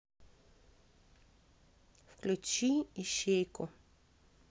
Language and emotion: Russian, neutral